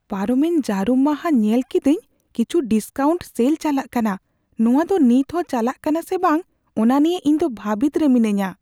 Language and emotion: Santali, fearful